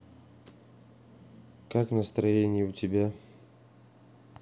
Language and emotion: Russian, neutral